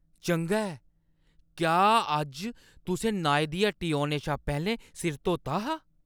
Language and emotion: Dogri, surprised